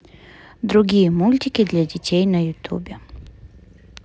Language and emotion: Russian, neutral